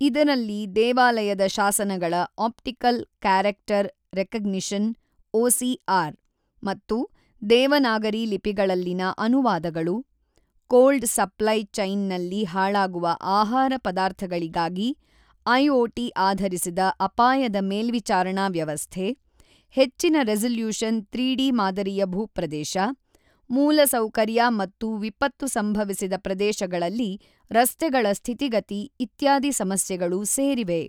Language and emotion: Kannada, neutral